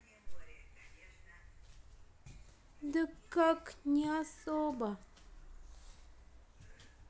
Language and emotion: Russian, sad